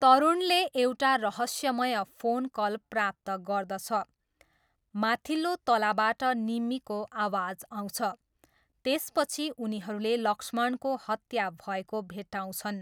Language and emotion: Nepali, neutral